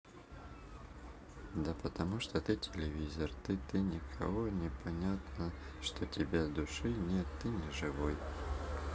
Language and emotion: Russian, sad